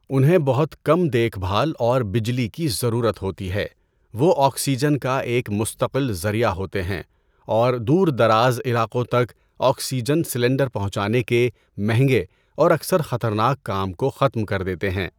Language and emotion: Urdu, neutral